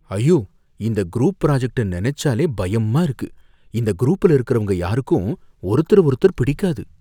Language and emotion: Tamil, fearful